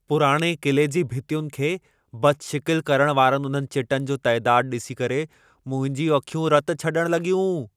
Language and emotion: Sindhi, angry